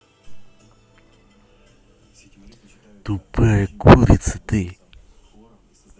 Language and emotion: Russian, angry